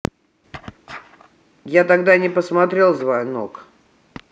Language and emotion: Russian, neutral